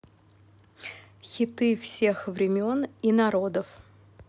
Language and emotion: Russian, neutral